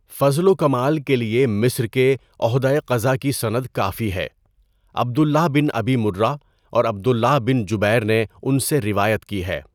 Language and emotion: Urdu, neutral